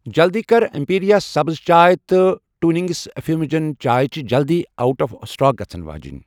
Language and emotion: Kashmiri, neutral